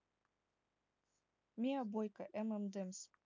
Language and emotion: Russian, neutral